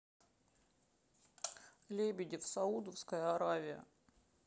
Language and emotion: Russian, sad